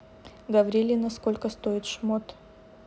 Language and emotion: Russian, neutral